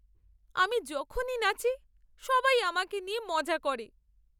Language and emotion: Bengali, sad